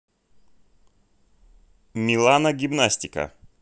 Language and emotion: Russian, neutral